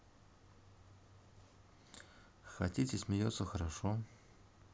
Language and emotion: Russian, neutral